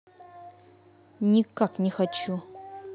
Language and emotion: Russian, angry